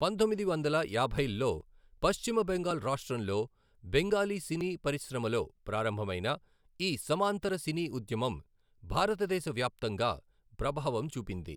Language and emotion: Telugu, neutral